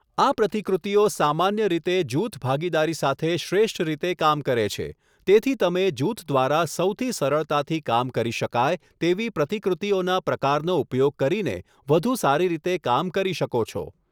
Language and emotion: Gujarati, neutral